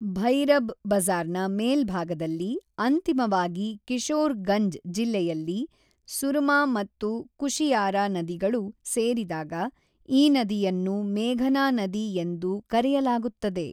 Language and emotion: Kannada, neutral